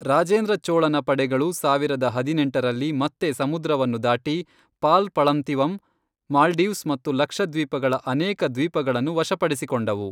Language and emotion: Kannada, neutral